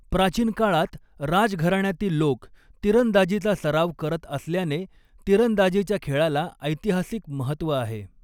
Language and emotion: Marathi, neutral